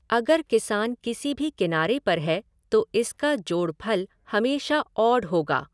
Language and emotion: Hindi, neutral